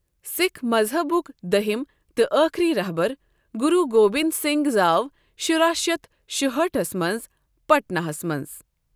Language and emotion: Kashmiri, neutral